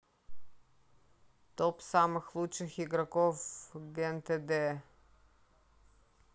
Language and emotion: Russian, neutral